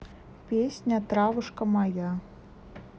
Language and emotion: Russian, neutral